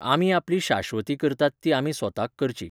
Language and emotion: Goan Konkani, neutral